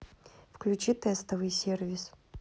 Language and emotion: Russian, neutral